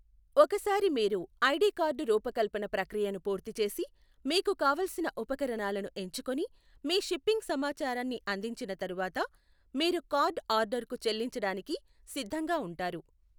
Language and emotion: Telugu, neutral